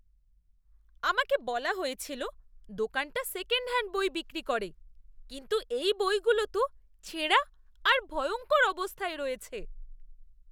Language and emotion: Bengali, disgusted